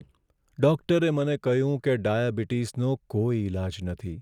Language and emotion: Gujarati, sad